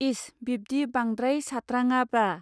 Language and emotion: Bodo, neutral